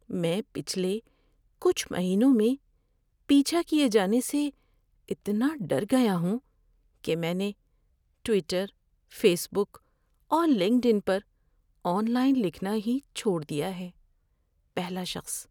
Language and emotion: Urdu, fearful